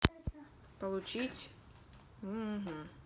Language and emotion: Russian, neutral